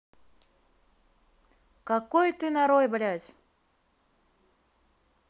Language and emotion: Russian, angry